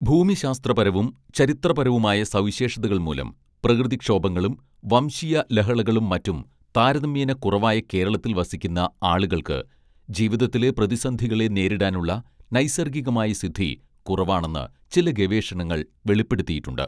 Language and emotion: Malayalam, neutral